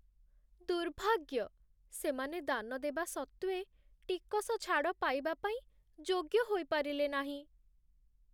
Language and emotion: Odia, sad